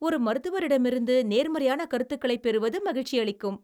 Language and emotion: Tamil, happy